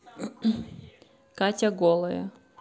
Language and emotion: Russian, neutral